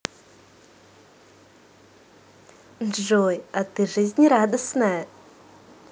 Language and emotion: Russian, positive